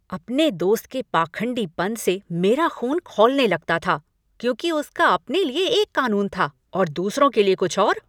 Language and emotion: Hindi, angry